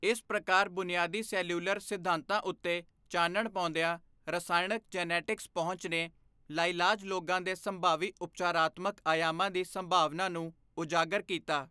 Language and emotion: Punjabi, neutral